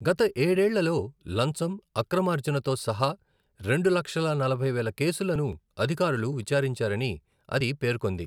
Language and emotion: Telugu, neutral